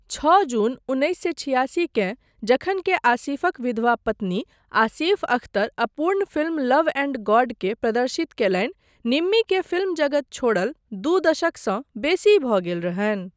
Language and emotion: Maithili, neutral